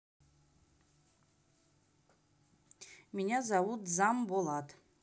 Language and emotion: Russian, neutral